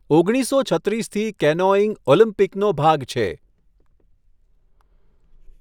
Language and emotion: Gujarati, neutral